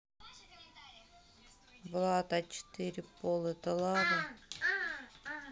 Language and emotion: Russian, neutral